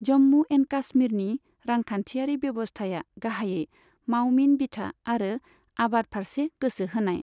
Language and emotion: Bodo, neutral